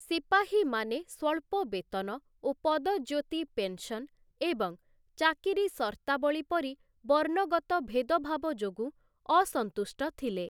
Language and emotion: Odia, neutral